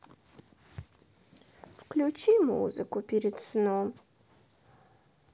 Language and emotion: Russian, sad